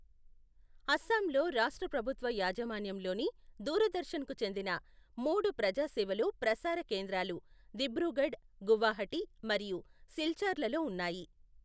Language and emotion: Telugu, neutral